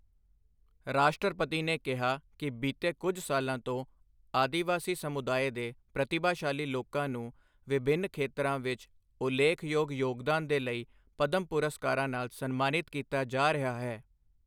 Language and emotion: Punjabi, neutral